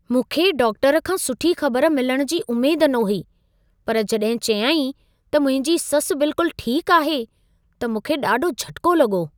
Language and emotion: Sindhi, surprised